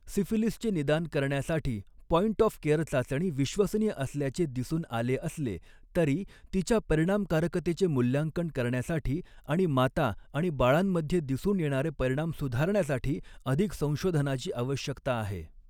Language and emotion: Marathi, neutral